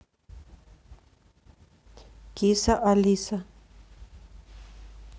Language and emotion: Russian, neutral